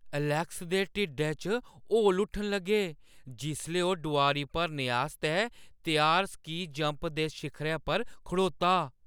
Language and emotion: Dogri, fearful